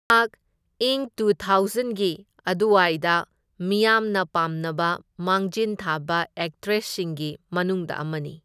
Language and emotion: Manipuri, neutral